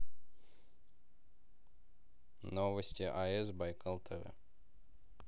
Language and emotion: Russian, neutral